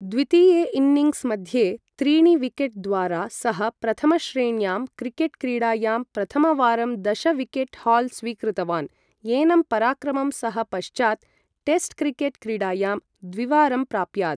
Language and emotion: Sanskrit, neutral